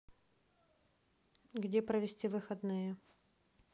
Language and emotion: Russian, neutral